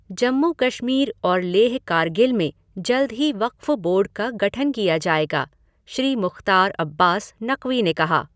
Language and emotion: Hindi, neutral